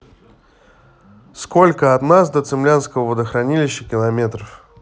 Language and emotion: Russian, neutral